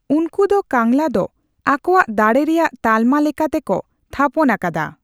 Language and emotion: Santali, neutral